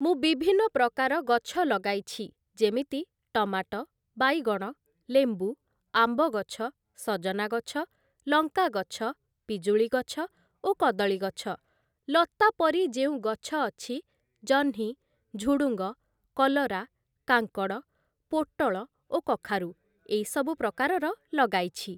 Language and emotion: Odia, neutral